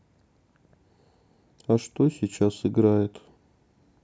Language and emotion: Russian, sad